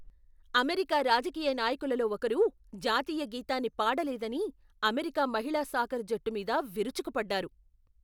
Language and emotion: Telugu, angry